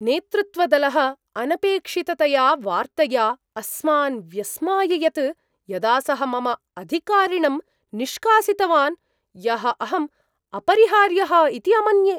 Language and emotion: Sanskrit, surprised